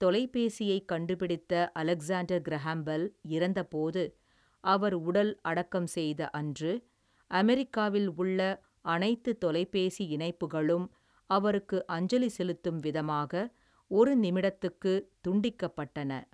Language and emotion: Tamil, neutral